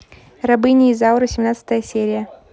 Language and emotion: Russian, neutral